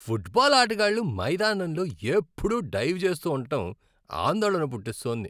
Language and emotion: Telugu, disgusted